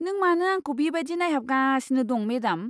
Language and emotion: Bodo, disgusted